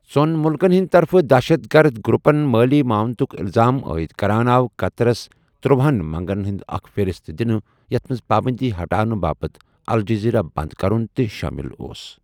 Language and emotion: Kashmiri, neutral